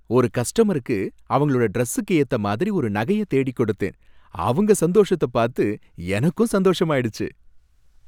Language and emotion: Tamil, happy